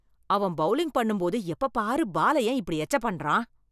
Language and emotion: Tamil, disgusted